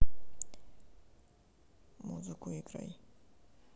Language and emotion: Russian, sad